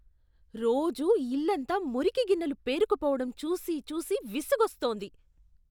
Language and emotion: Telugu, disgusted